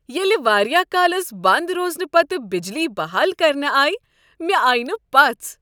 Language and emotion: Kashmiri, happy